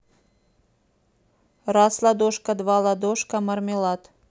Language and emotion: Russian, neutral